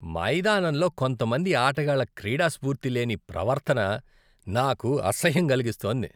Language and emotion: Telugu, disgusted